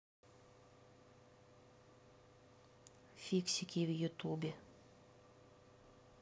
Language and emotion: Russian, neutral